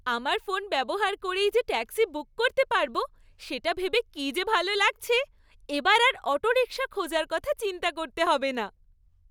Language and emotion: Bengali, happy